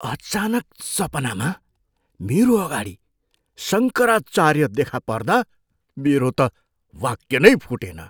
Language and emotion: Nepali, surprised